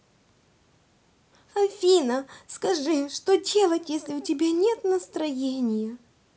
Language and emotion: Russian, sad